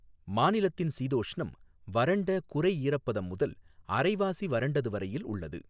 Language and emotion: Tamil, neutral